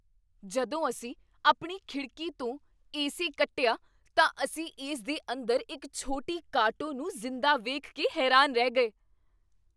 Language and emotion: Punjabi, surprised